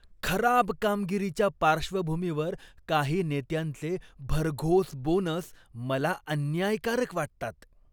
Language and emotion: Marathi, disgusted